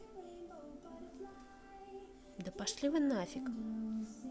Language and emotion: Russian, neutral